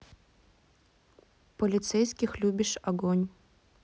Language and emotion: Russian, neutral